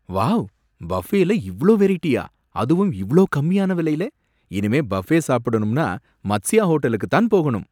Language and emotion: Tamil, surprised